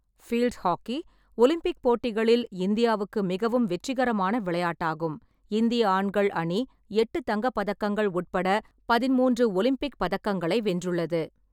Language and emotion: Tamil, neutral